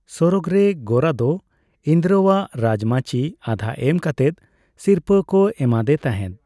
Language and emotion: Santali, neutral